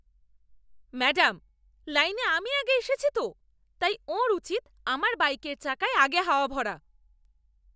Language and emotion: Bengali, angry